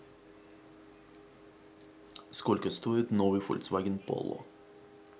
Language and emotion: Russian, neutral